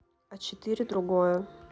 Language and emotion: Russian, neutral